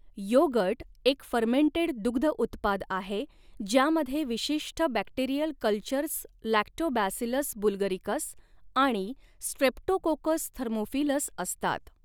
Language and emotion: Marathi, neutral